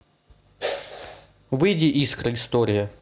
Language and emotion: Russian, neutral